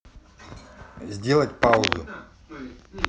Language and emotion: Russian, neutral